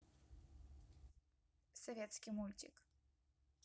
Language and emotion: Russian, neutral